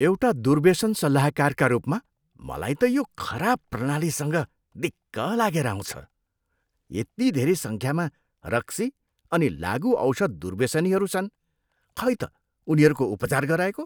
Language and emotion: Nepali, disgusted